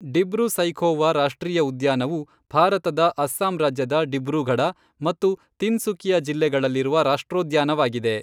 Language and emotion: Kannada, neutral